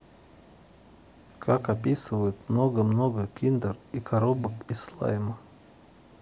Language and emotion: Russian, neutral